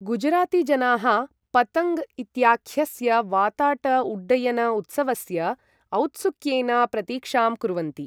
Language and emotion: Sanskrit, neutral